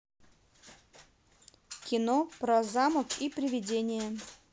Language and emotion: Russian, neutral